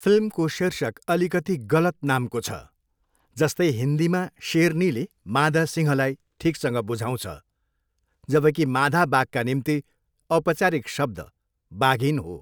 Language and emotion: Nepali, neutral